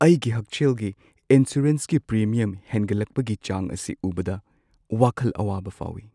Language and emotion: Manipuri, sad